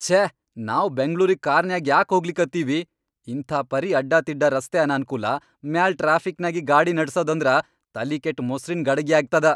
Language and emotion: Kannada, angry